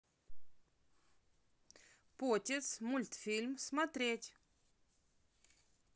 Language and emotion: Russian, positive